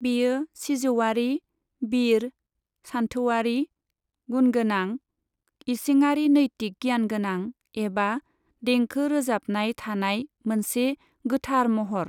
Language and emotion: Bodo, neutral